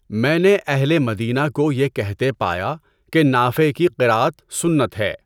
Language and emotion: Urdu, neutral